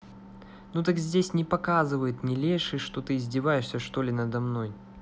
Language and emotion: Russian, angry